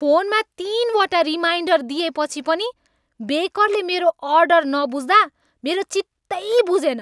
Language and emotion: Nepali, angry